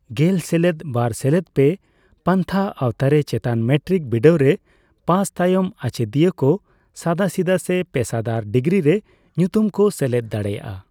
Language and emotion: Santali, neutral